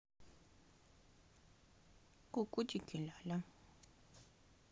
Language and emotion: Russian, neutral